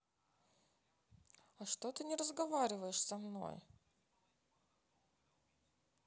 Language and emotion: Russian, sad